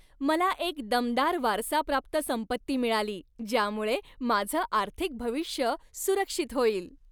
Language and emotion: Marathi, happy